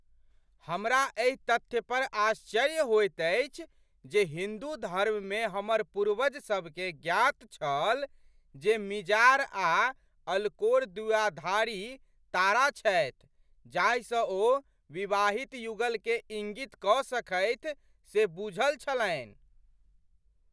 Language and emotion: Maithili, surprised